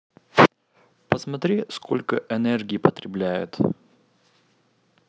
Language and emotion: Russian, neutral